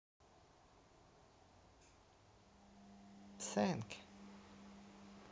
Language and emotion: Russian, neutral